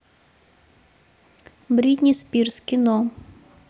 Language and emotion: Russian, neutral